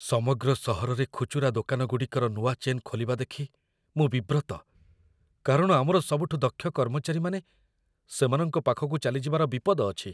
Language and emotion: Odia, fearful